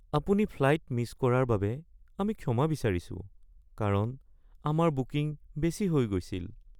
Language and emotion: Assamese, sad